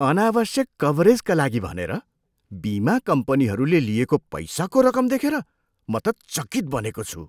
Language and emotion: Nepali, surprised